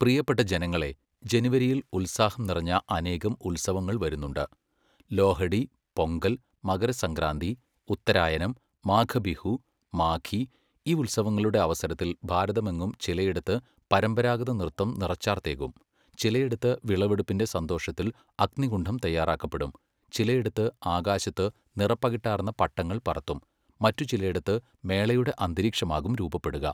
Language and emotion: Malayalam, neutral